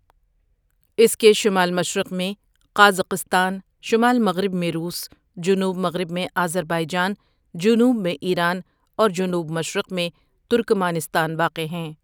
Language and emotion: Urdu, neutral